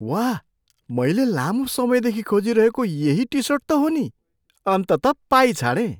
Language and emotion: Nepali, surprised